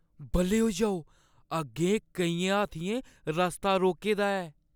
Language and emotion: Dogri, fearful